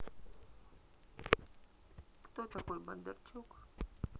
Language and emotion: Russian, neutral